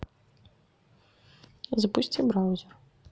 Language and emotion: Russian, neutral